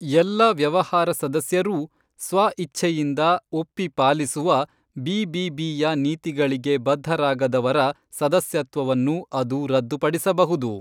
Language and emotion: Kannada, neutral